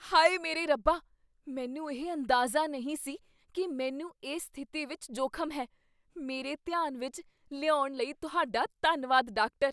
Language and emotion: Punjabi, surprised